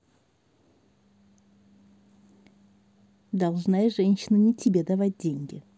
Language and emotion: Russian, neutral